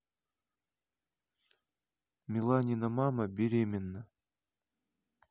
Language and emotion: Russian, neutral